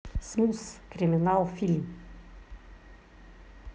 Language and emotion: Russian, neutral